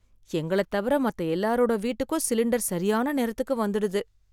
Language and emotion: Tamil, sad